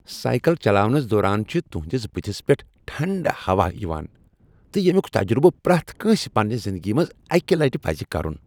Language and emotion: Kashmiri, happy